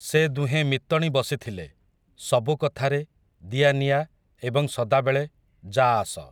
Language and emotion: Odia, neutral